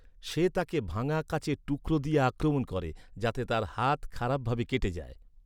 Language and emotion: Bengali, neutral